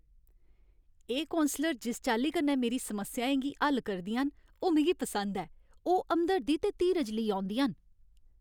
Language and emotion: Dogri, happy